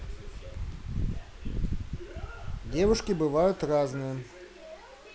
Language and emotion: Russian, neutral